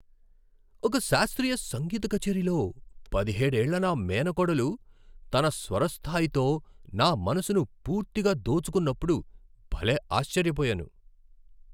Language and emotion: Telugu, surprised